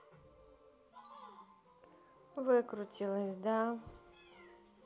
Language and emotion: Russian, neutral